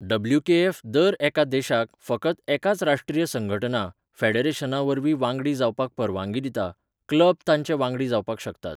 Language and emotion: Goan Konkani, neutral